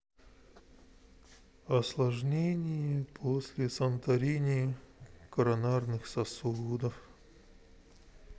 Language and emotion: Russian, sad